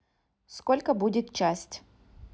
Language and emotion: Russian, neutral